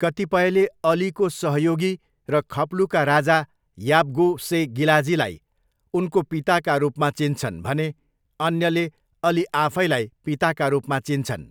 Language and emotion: Nepali, neutral